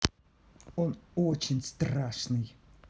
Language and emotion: Russian, neutral